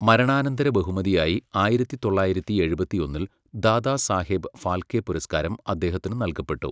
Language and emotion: Malayalam, neutral